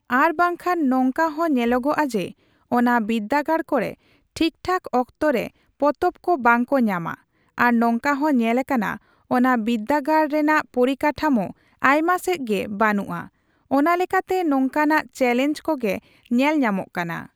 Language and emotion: Santali, neutral